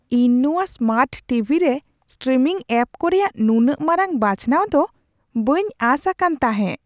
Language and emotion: Santali, surprised